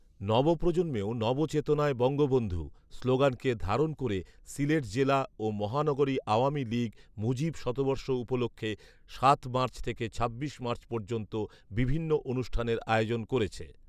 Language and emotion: Bengali, neutral